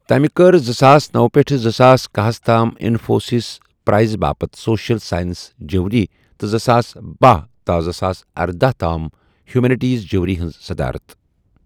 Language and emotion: Kashmiri, neutral